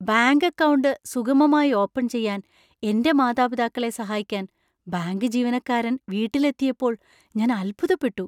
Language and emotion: Malayalam, surprised